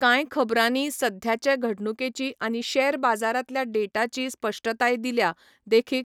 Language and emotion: Goan Konkani, neutral